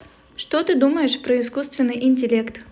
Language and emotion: Russian, positive